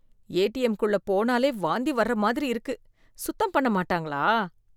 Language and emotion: Tamil, disgusted